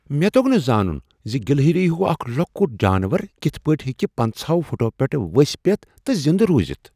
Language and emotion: Kashmiri, surprised